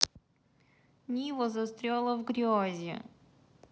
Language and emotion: Russian, sad